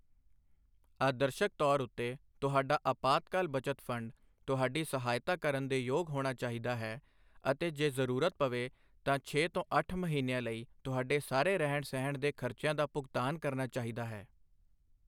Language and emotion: Punjabi, neutral